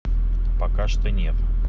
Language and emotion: Russian, neutral